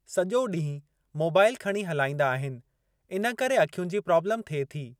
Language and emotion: Sindhi, neutral